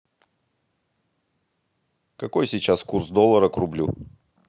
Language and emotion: Russian, neutral